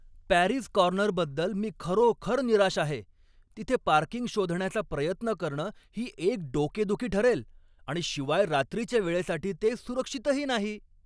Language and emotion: Marathi, angry